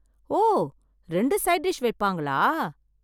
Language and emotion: Tamil, surprised